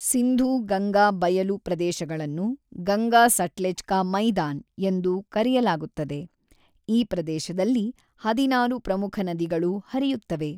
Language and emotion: Kannada, neutral